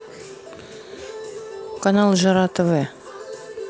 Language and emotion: Russian, neutral